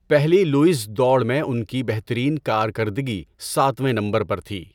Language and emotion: Urdu, neutral